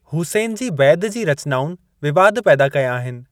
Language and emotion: Sindhi, neutral